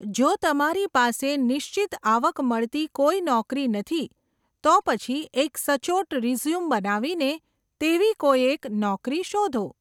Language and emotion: Gujarati, neutral